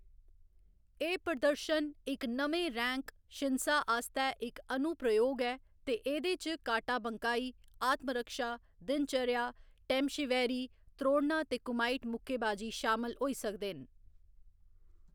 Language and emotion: Dogri, neutral